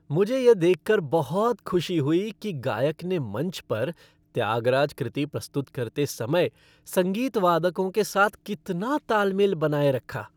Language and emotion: Hindi, happy